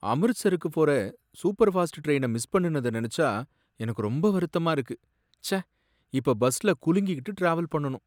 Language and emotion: Tamil, sad